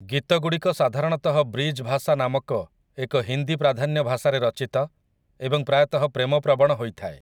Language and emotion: Odia, neutral